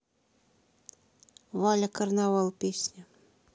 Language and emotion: Russian, neutral